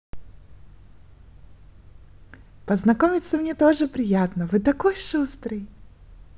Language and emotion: Russian, positive